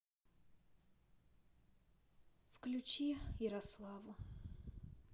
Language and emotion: Russian, sad